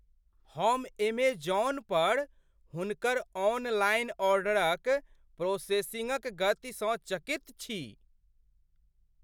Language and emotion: Maithili, surprised